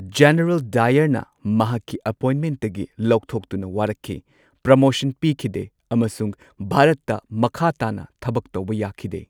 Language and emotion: Manipuri, neutral